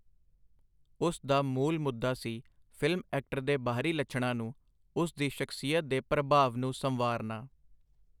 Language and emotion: Punjabi, neutral